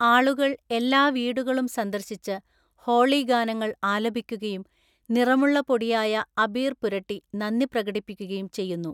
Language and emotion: Malayalam, neutral